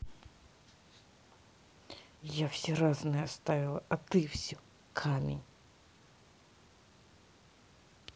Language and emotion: Russian, angry